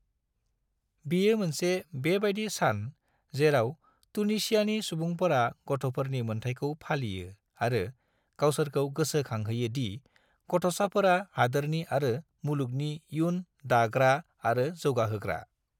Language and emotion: Bodo, neutral